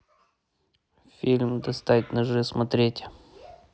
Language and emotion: Russian, neutral